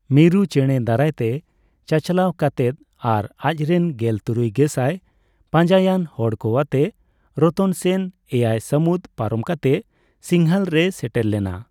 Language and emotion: Santali, neutral